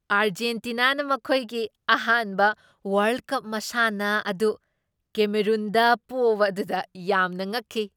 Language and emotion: Manipuri, surprised